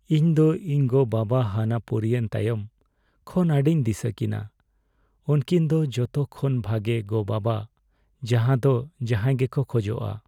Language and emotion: Santali, sad